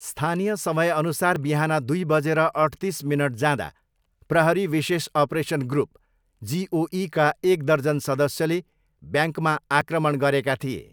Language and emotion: Nepali, neutral